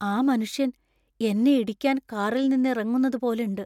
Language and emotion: Malayalam, fearful